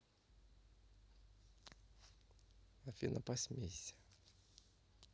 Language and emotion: Russian, neutral